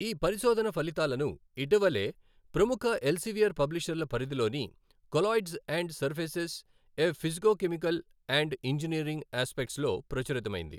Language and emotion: Telugu, neutral